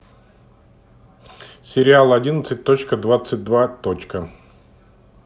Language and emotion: Russian, neutral